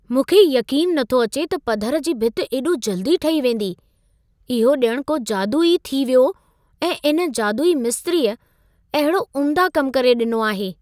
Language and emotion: Sindhi, surprised